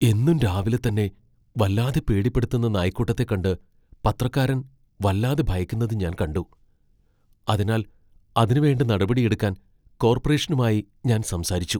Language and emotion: Malayalam, fearful